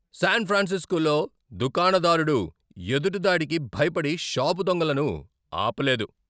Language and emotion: Telugu, angry